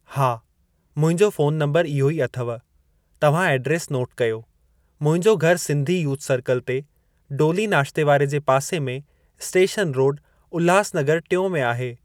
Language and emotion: Sindhi, neutral